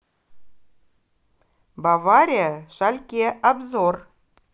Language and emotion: Russian, positive